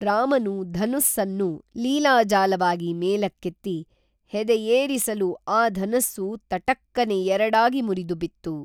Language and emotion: Kannada, neutral